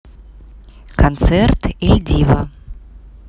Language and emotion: Russian, neutral